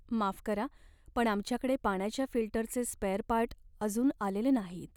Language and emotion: Marathi, sad